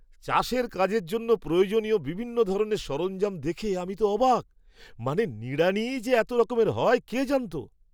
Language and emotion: Bengali, surprised